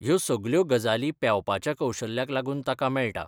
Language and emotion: Goan Konkani, neutral